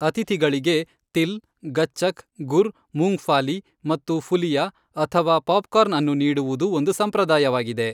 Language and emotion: Kannada, neutral